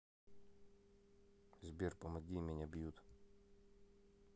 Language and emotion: Russian, neutral